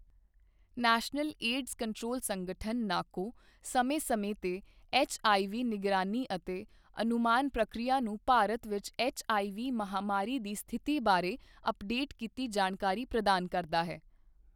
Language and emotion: Punjabi, neutral